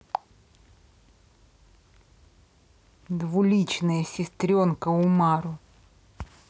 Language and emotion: Russian, angry